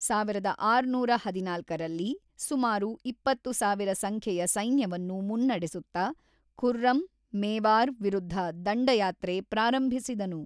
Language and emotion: Kannada, neutral